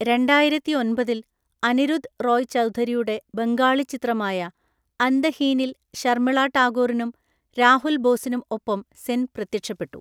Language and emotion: Malayalam, neutral